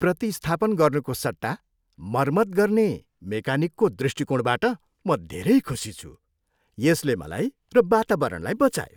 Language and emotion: Nepali, happy